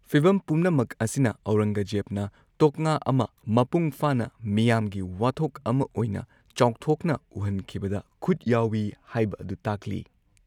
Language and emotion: Manipuri, neutral